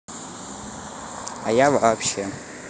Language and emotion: Russian, neutral